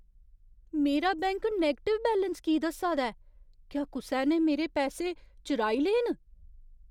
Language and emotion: Dogri, fearful